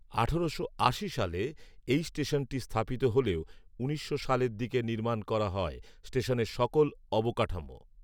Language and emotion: Bengali, neutral